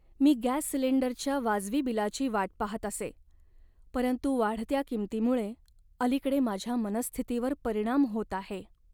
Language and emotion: Marathi, sad